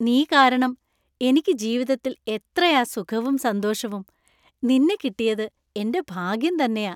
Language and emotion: Malayalam, happy